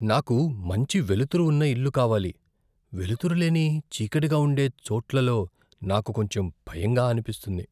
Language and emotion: Telugu, fearful